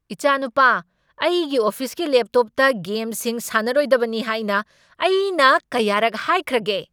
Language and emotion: Manipuri, angry